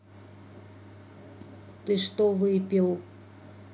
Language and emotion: Russian, neutral